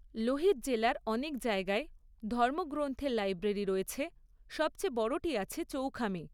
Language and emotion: Bengali, neutral